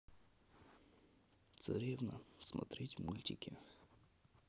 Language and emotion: Russian, sad